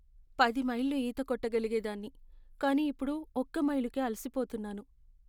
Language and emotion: Telugu, sad